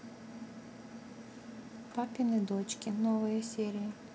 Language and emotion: Russian, neutral